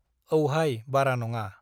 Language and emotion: Bodo, neutral